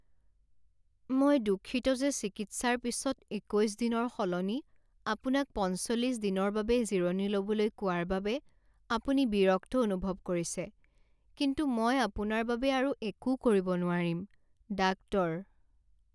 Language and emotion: Assamese, sad